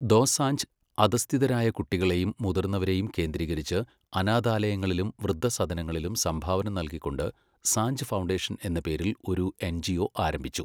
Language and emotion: Malayalam, neutral